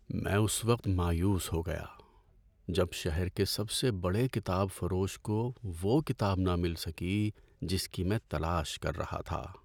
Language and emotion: Urdu, sad